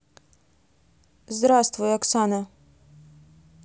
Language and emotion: Russian, neutral